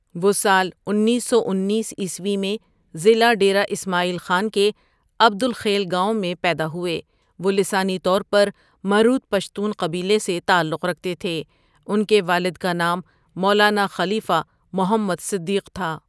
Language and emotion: Urdu, neutral